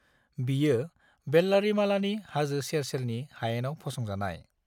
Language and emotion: Bodo, neutral